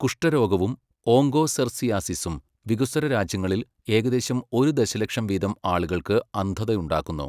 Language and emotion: Malayalam, neutral